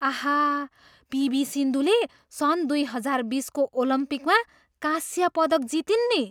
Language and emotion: Nepali, surprised